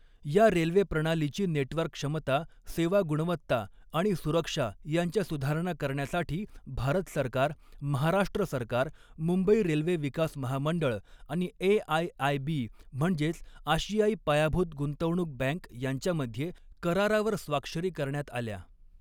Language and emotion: Marathi, neutral